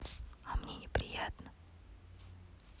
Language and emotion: Russian, neutral